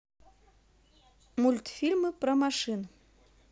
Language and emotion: Russian, neutral